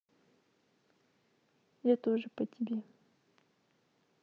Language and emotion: Russian, sad